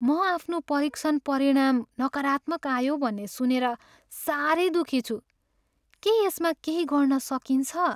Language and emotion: Nepali, sad